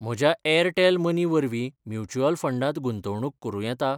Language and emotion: Goan Konkani, neutral